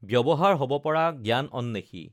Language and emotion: Assamese, neutral